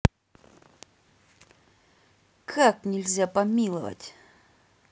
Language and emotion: Russian, angry